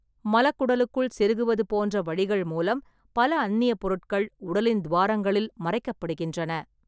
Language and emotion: Tamil, neutral